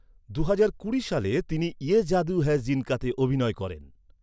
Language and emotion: Bengali, neutral